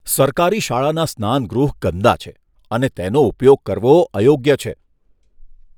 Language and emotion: Gujarati, disgusted